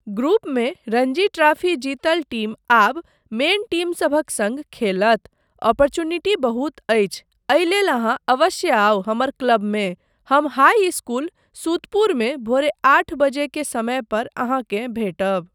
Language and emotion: Maithili, neutral